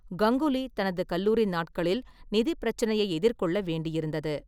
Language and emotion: Tamil, neutral